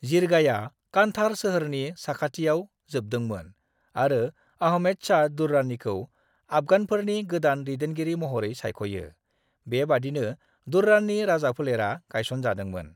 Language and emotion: Bodo, neutral